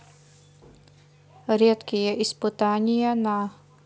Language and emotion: Russian, neutral